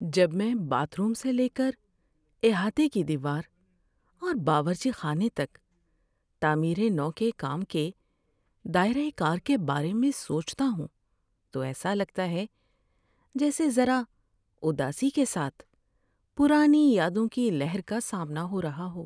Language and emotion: Urdu, sad